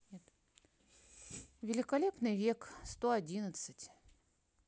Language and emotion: Russian, neutral